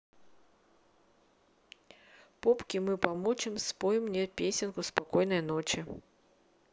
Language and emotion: Russian, neutral